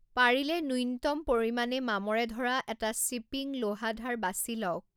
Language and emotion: Assamese, neutral